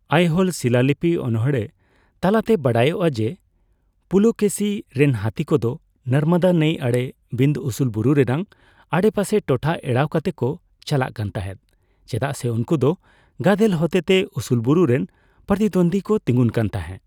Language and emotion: Santali, neutral